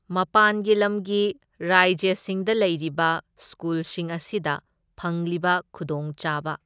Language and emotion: Manipuri, neutral